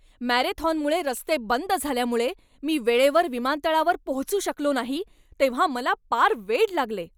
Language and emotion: Marathi, angry